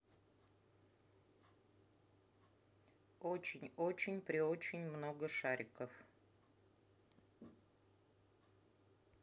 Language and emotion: Russian, neutral